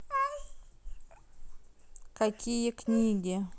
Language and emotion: Russian, neutral